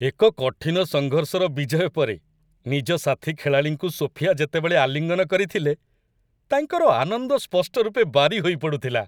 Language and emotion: Odia, happy